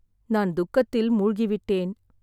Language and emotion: Tamil, sad